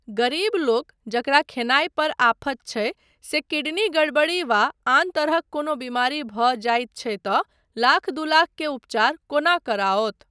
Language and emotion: Maithili, neutral